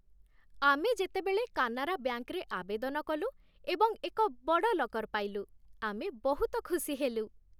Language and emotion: Odia, happy